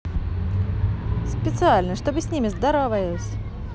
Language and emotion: Russian, positive